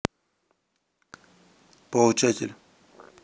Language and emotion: Russian, neutral